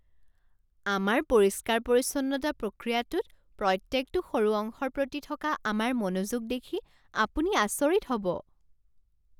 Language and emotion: Assamese, surprised